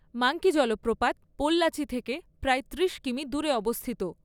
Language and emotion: Bengali, neutral